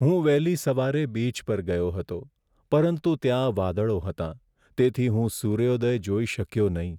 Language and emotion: Gujarati, sad